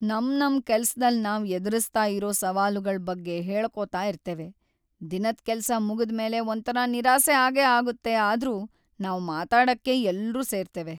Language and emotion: Kannada, sad